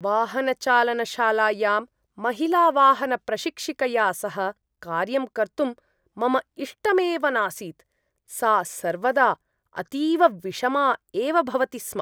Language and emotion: Sanskrit, disgusted